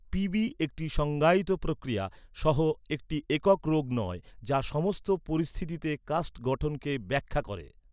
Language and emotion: Bengali, neutral